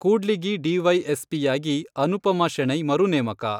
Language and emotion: Kannada, neutral